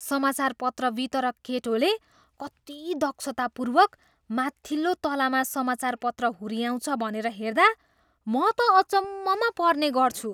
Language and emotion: Nepali, surprised